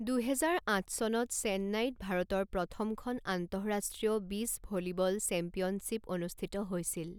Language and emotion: Assamese, neutral